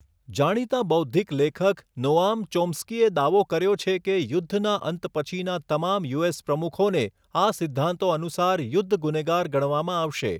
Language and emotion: Gujarati, neutral